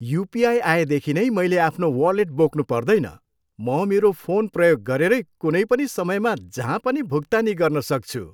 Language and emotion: Nepali, happy